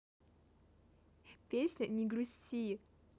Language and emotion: Russian, positive